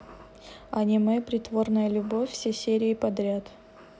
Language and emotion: Russian, neutral